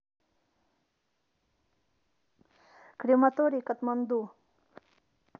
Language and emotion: Russian, neutral